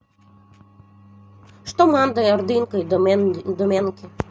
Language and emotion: Russian, neutral